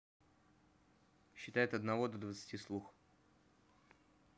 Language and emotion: Russian, neutral